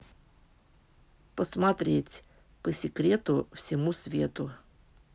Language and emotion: Russian, neutral